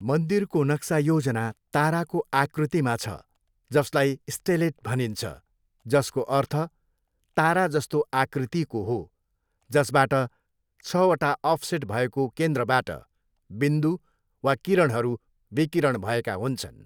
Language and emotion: Nepali, neutral